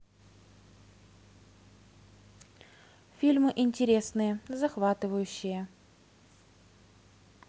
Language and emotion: Russian, neutral